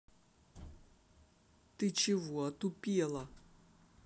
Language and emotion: Russian, angry